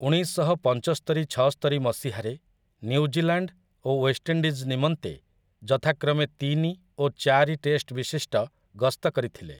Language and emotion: Odia, neutral